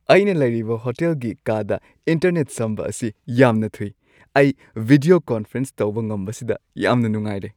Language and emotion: Manipuri, happy